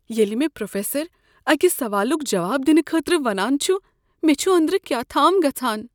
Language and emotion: Kashmiri, fearful